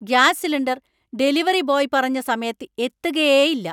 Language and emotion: Malayalam, angry